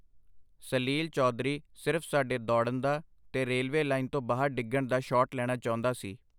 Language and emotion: Punjabi, neutral